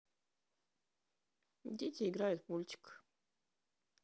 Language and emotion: Russian, neutral